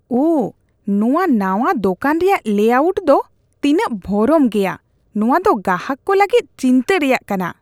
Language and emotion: Santali, disgusted